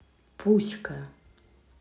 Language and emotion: Russian, neutral